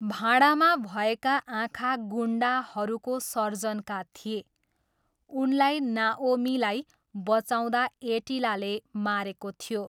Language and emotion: Nepali, neutral